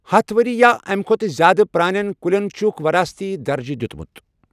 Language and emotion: Kashmiri, neutral